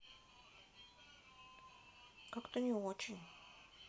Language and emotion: Russian, sad